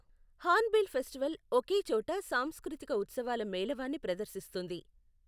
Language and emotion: Telugu, neutral